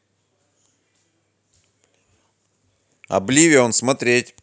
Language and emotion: Russian, positive